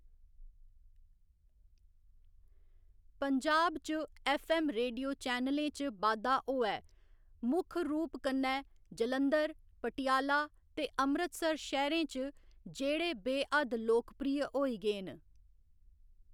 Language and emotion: Dogri, neutral